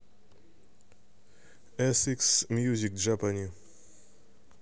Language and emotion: Russian, neutral